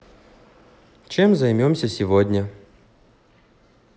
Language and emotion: Russian, neutral